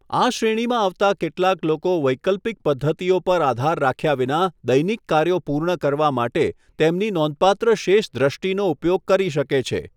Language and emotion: Gujarati, neutral